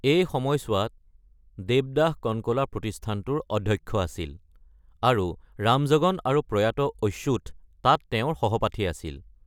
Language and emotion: Assamese, neutral